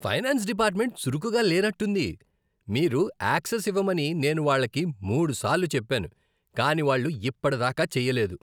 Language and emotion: Telugu, disgusted